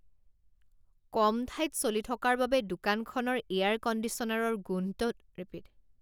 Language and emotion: Assamese, disgusted